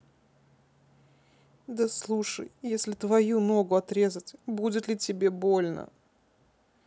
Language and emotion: Russian, sad